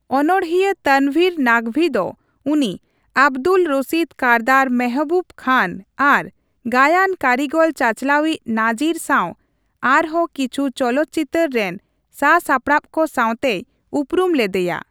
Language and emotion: Santali, neutral